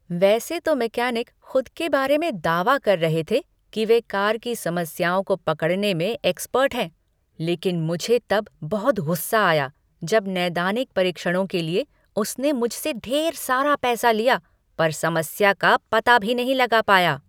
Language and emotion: Hindi, angry